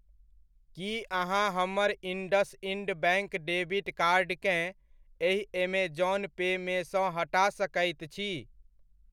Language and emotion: Maithili, neutral